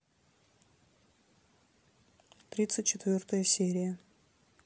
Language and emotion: Russian, neutral